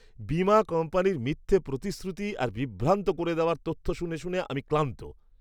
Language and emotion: Bengali, disgusted